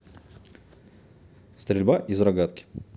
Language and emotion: Russian, neutral